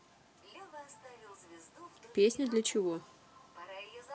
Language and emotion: Russian, neutral